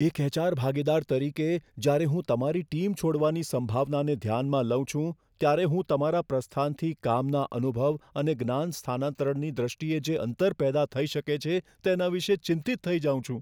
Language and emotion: Gujarati, fearful